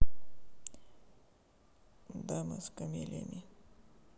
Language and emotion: Russian, sad